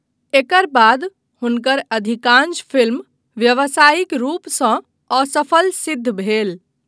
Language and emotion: Maithili, neutral